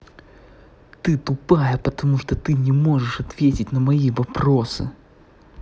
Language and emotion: Russian, angry